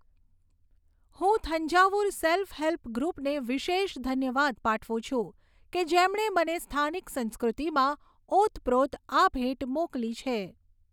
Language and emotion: Gujarati, neutral